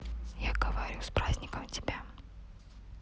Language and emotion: Russian, neutral